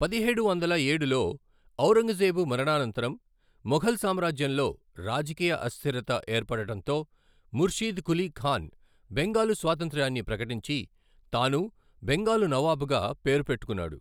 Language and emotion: Telugu, neutral